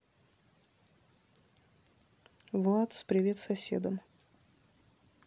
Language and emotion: Russian, neutral